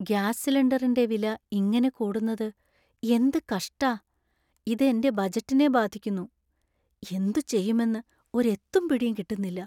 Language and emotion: Malayalam, sad